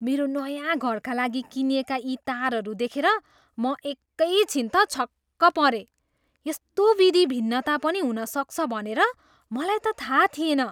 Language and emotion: Nepali, surprised